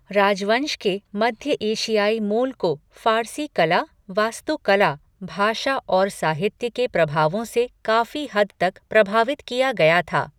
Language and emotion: Hindi, neutral